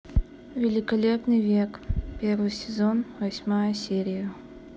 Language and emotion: Russian, neutral